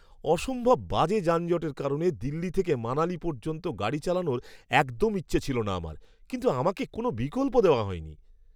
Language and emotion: Bengali, disgusted